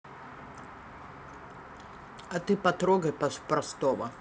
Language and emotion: Russian, neutral